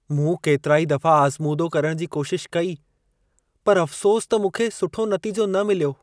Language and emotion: Sindhi, sad